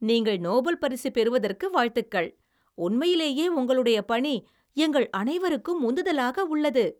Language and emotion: Tamil, happy